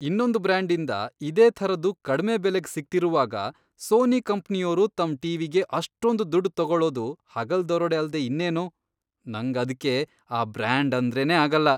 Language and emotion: Kannada, disgusted